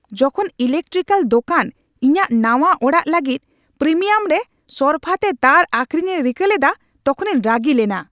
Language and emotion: Santali, angry